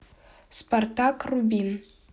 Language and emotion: Russian, neutral